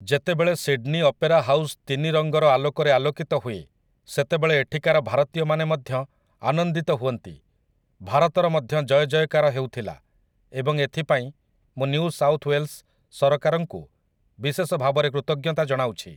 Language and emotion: Odia, neutral